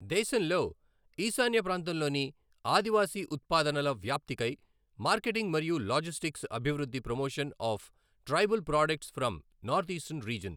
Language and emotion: Telugu, neutral